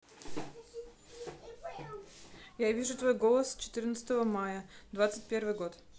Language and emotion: Russian, neutral